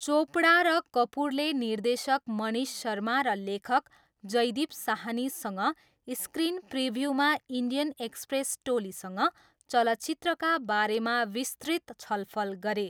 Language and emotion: Nepali, neutral